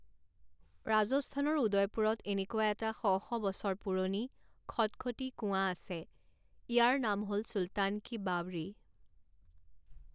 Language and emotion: Assamese, neutral